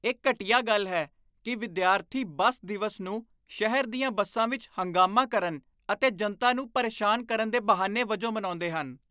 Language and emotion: Punjabi, disgusted